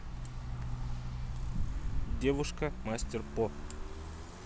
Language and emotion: Russian, neutral